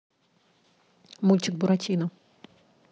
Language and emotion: Russian, neutral